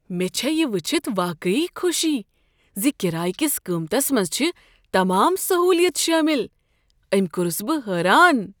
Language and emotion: Kashmiri, surprised